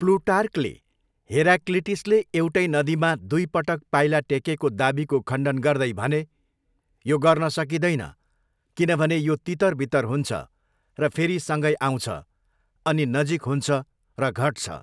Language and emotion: Nepali, neutral